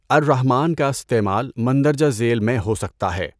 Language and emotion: Urdu, neutral